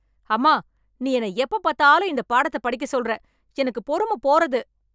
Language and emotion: Tamil, angry